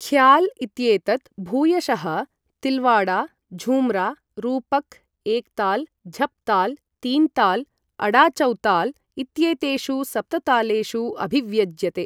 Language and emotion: Sanskrit, neutral